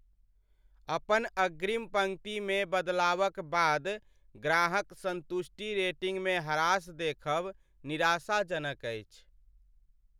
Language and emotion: Maithili, sad